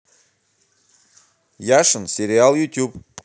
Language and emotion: Russian, positive